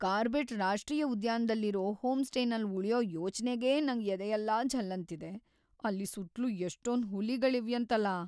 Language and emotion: Kannada, fearful